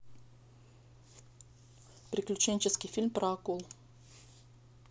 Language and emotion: Russian, neutral